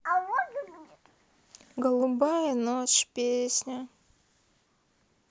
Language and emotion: Russian, sad